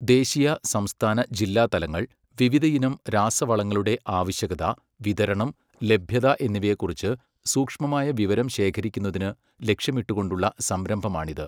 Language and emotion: Malayalam, neutral